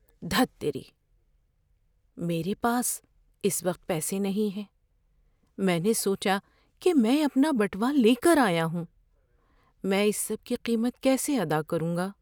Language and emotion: Urdu, fearful